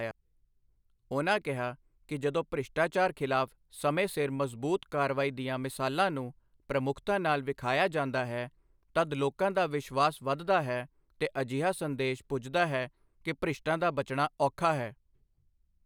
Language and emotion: Punjabi, neutral